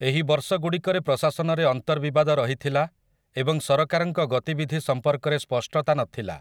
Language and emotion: Odia, neutral